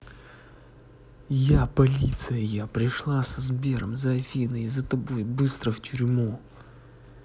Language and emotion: Russian, angry